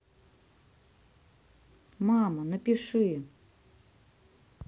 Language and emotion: Russian, neutral